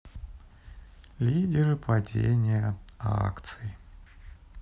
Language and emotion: Russian, sad